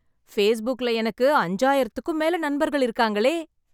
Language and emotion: Tamil, happy